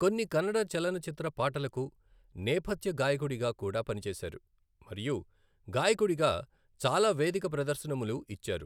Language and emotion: Telugu, neutral